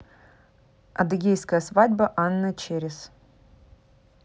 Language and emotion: Russian, neutral